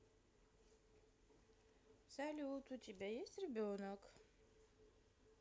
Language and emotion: Russian, positive